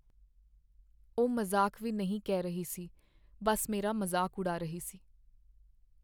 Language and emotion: Punjabi, sad